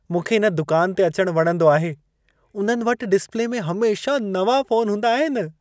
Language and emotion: Sindhi, happy